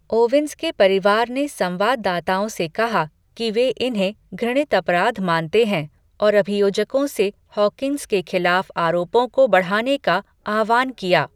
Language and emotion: Hindi, neutral